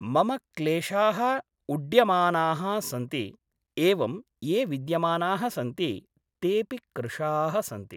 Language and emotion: Sanskrit, neutral